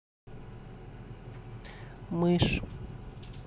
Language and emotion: Russian, neutral